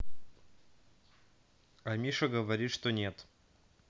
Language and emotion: Russian, neutral